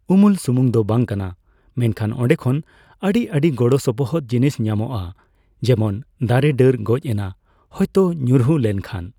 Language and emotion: Santali, neutral